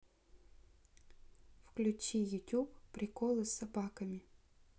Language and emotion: Russian, neutral